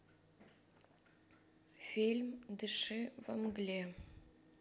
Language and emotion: Russian, sad